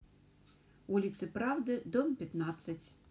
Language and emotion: Russian, neutral